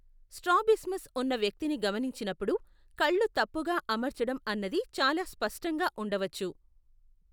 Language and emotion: Telugu, neutral